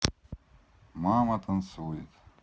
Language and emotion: Russian, neutral